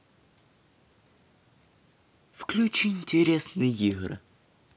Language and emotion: Russian, neutral